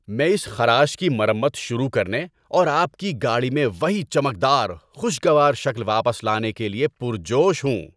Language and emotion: Urdu, happy